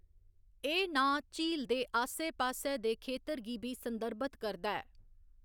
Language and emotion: Dogri, neutral